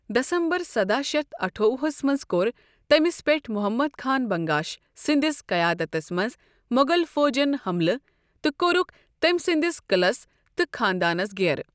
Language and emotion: Kashmiri, neutral